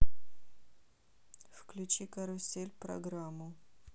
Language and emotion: Russian, neutral